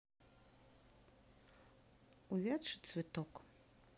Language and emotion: Russian, sad